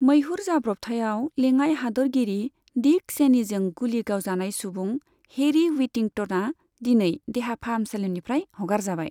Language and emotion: Bodo, neutral